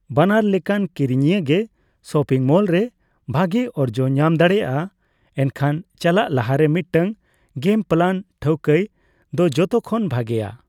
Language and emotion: Santali, neutral